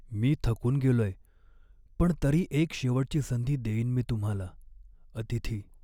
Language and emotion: Marathi, sad